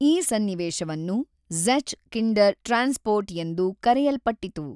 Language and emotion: Kannada, neutral